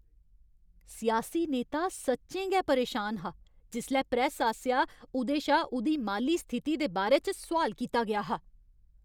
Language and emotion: Dogri, angry